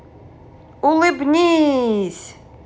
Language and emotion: Russian, positive